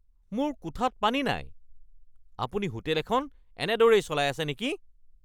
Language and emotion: Assamese, angry